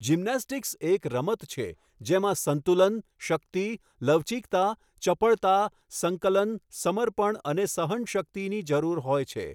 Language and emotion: Gujarati, neutral